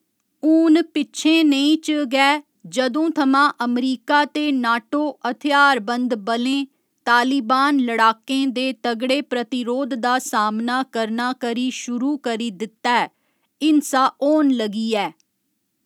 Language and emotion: Dogri, neutral